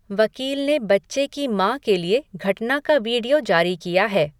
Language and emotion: Hindi, neutral